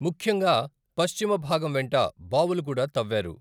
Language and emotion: Telugu, neutral